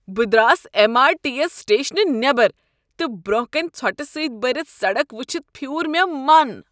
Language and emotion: Kashmiri, disgusted